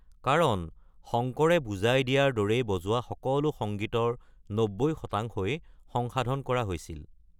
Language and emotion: Assamese, neutral